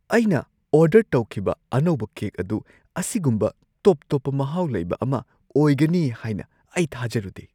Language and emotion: Manipuri, surprised